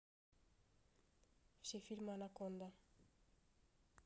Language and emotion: Russian, neutral